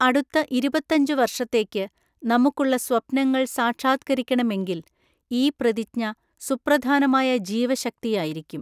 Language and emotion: Malayalam, neutral